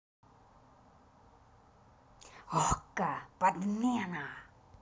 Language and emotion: Russian, angry